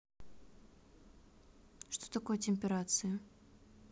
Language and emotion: Russian, neutral